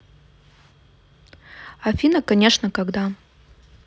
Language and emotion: Russian, neutral